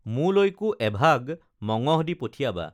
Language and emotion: Assamese, neutral